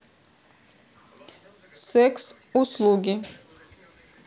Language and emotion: Russian, neutral